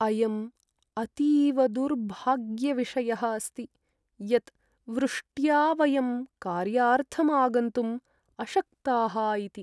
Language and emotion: Sanskrit, sad